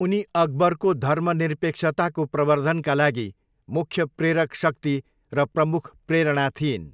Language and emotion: Nepali, neutral